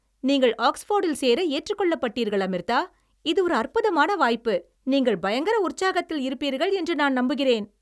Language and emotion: Tamil, happy